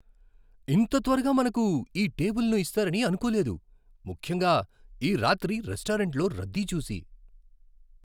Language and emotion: Telugu, surprised